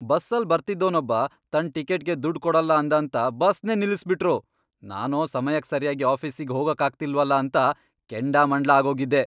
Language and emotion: Kannada, angry